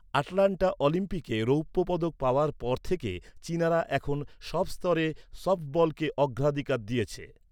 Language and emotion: Bengali, neutral